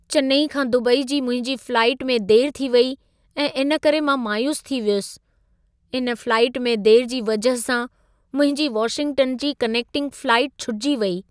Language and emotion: Sindhi, sad